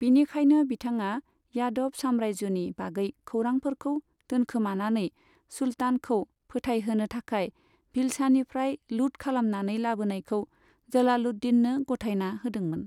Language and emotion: Bodo, neutral